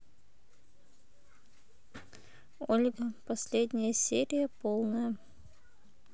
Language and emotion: Russian, neutral